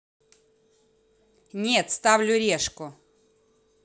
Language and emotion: Russian, angry